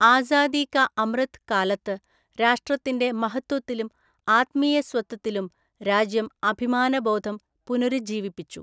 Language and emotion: Malayalam, neutral